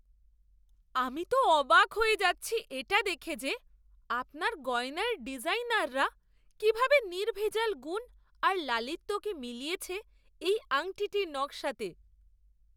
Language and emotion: Bengali, surprised